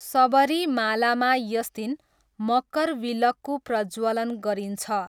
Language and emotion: Nepali, neutral